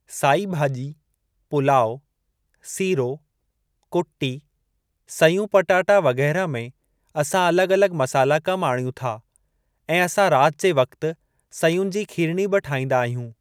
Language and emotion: Sindhi, neutral